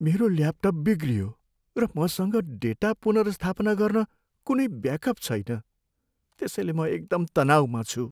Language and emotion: Nepali, sad